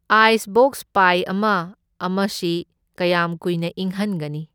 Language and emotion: Manipuri, neutral